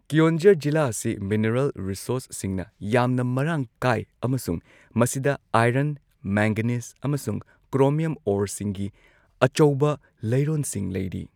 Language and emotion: Manipuri, neutral